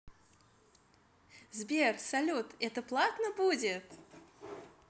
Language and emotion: Russian, positive